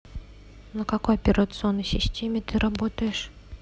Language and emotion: Russian, neutral